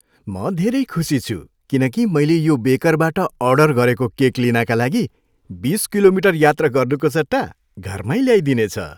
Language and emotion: Nepali, happy